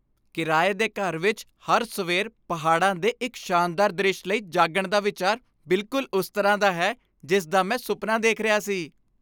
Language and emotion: Punjabi, happy